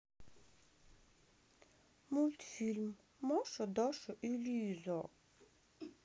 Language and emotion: Russian, sad